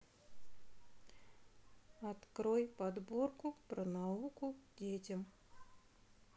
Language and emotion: Russian, neutral